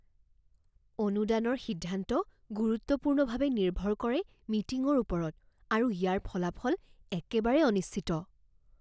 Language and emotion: Assamese, fearful